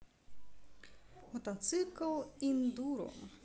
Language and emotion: Russian, neutral